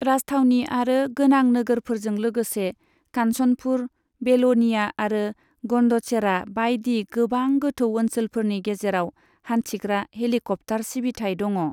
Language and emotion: Bodo, neutral